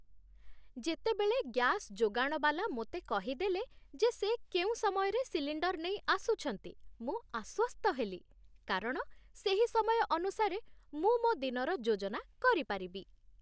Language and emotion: Odia, happy